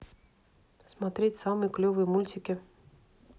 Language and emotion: Russian, neutral